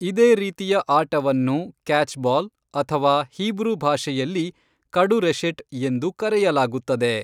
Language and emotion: Kannada, neutral